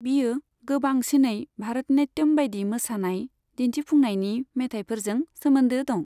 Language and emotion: Bodo, neutral